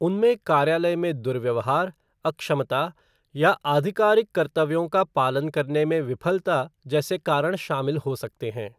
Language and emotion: Hindi, neutral